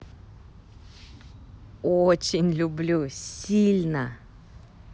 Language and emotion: Russian, positive